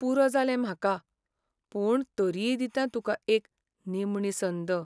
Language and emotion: Goan Konkani, sad